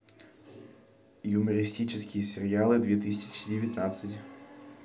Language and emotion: Russian, neutral